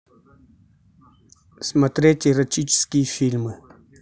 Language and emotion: Russian, neutral